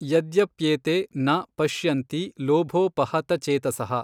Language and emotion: Kannada, neutral